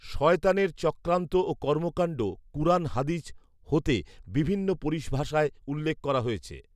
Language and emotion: Bengali, neutral